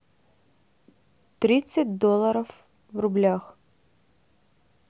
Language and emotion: Russian, neutral